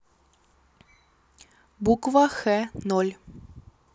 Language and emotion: Russian, neutral